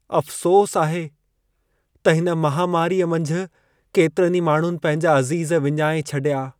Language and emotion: Sindhi, sad